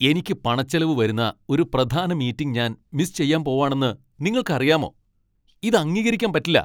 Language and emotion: Malayalam, angry